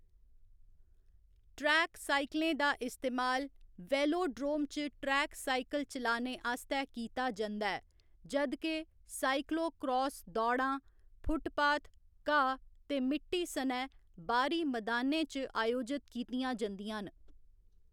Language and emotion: Dogri, neutral